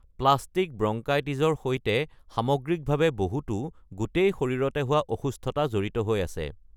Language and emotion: Assamese, neutral